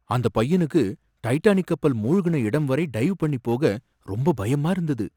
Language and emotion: Tamil, fearful